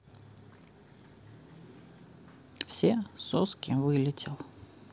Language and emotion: Russian, neutral